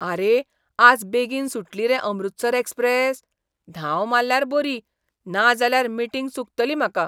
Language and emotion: Goan Konkani, surprised